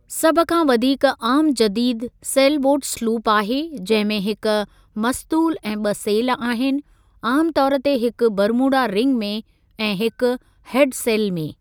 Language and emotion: Sindhi, neutral